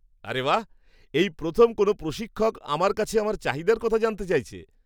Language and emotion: Bengali, surprised